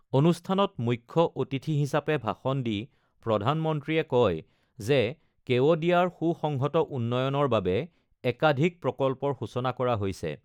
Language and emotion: Assamese, neutral